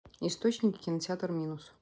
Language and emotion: Russian, neutral